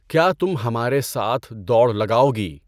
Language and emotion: Urdu, neutral